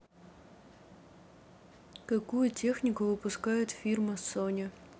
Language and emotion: Russian, neutral